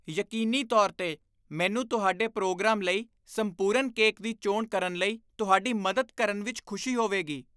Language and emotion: Punjabi, disgusted